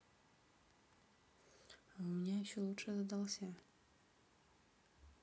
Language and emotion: Russian, neutral